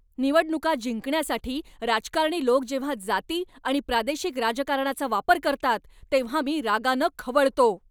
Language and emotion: Marathi, angry